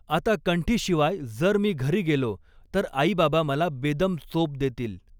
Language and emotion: Marathi, neutral